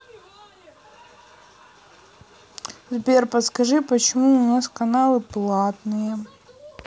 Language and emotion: Russian, neutral